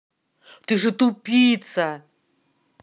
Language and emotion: Russian, angry